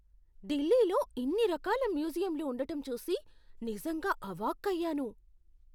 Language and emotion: Telugu, surprised